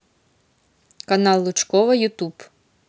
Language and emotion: Russian, neutral